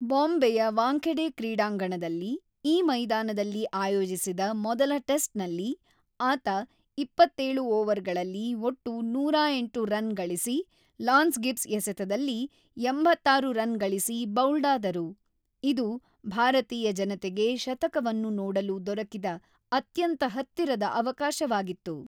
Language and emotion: Kannada, neutral